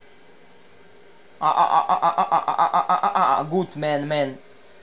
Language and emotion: Russian, neutral